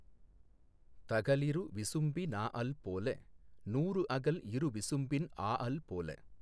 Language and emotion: Tamil, neutral